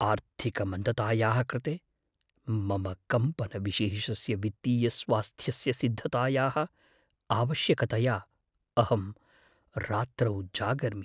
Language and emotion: Sanskrit, fearful